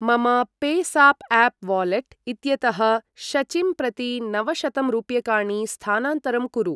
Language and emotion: Sanskrit, neutral